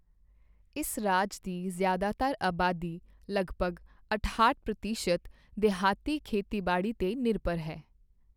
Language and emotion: Punjabi, neutral